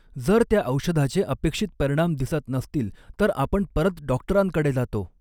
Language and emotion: Marathi, neutral